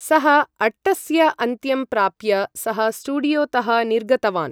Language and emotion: Sanskrit, neutral